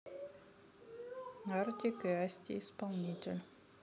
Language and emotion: Russian, neutral